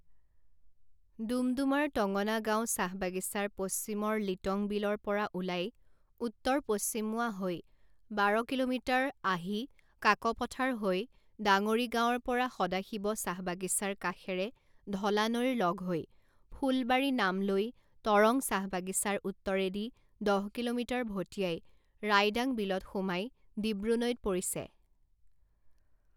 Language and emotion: Assamese, neutral